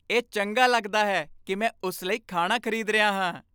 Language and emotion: Punjabi, happy